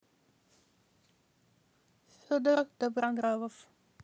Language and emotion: Russian, neutral